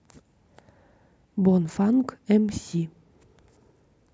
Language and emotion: Russian, neutral